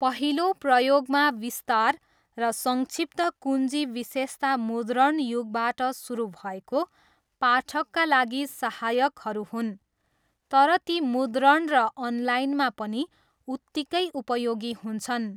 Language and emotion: Nepali, neutral